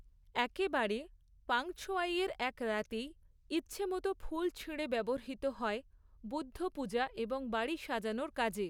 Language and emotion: Bengali, neutral